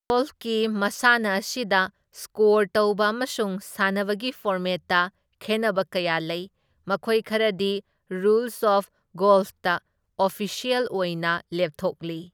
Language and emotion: Manipuri, neutral